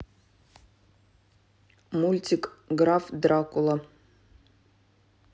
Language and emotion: Russian, neutral